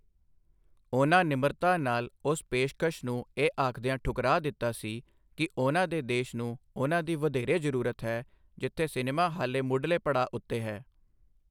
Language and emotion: Punjabi, neutral